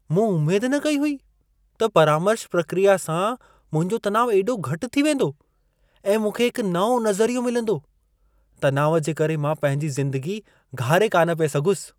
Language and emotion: Sindhi, surprised